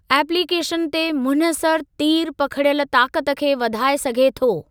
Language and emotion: Sindhi, neutral